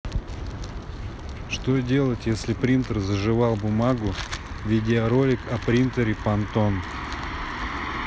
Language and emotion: Russian, neutral